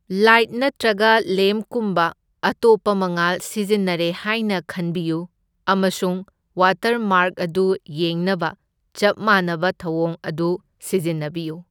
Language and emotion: Manipuri, neutral